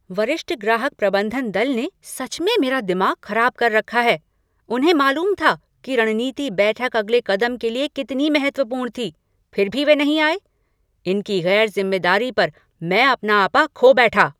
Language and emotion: Hindi, angry